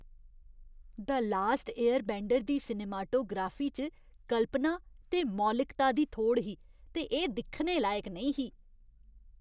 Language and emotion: Dogri, disgusted